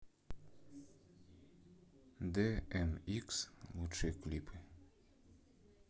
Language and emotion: Russian, neutral